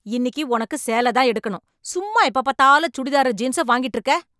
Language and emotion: Tamil, angry